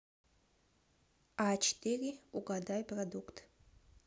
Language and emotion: Russian, neutral